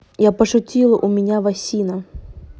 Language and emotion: Russian, neutral